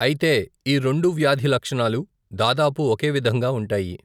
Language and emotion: Telugu, neutral